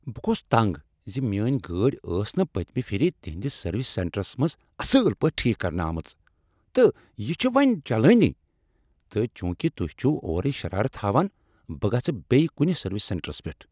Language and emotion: Kashmiri, angry